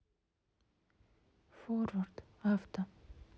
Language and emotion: Russian, sad